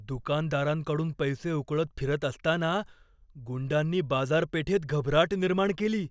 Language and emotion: Marathi, fearful